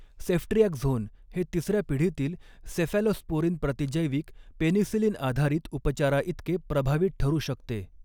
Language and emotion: Marathi, neutral